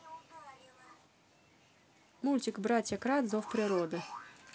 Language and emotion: Russian, positive